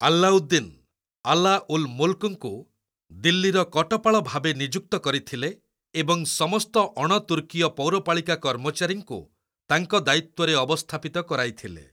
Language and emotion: Odia, neutral